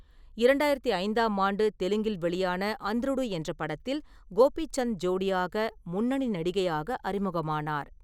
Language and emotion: Tamil, neutral